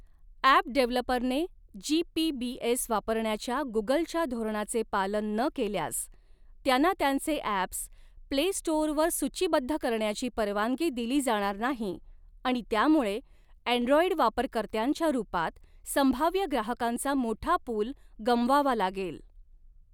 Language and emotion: Marathi, neutral